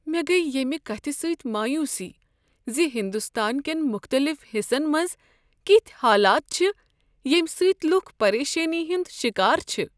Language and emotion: Kashmiri, sad